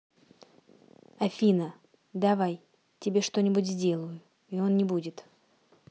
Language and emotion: Russian, neutral